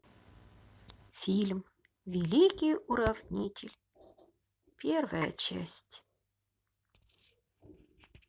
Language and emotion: Russian, positive